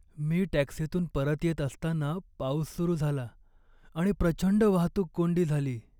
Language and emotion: Marathi, sad